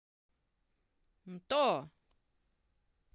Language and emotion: Russian, positive